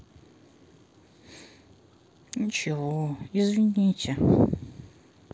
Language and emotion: Russian, sad